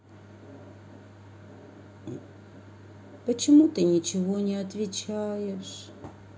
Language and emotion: Russian, sad